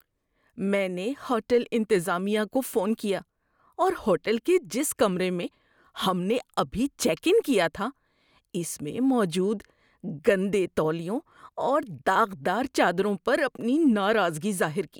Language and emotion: Urdu, disgusted